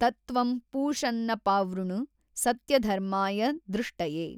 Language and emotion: Kannada, neutral